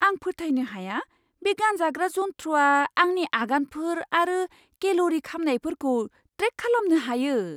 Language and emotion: Bodo, surprised